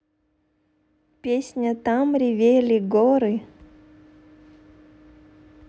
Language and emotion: Russian, neutral